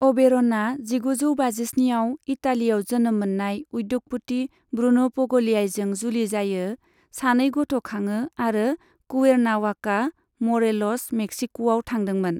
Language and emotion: Bodo, neutral